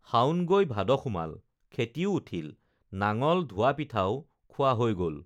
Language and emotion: Assamese, neutral